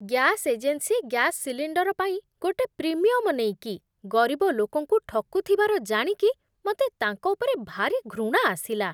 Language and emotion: Odia, disgusted